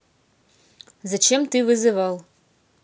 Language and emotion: Russian, neutral